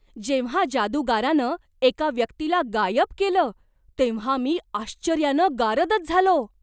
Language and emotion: Marathi, surprised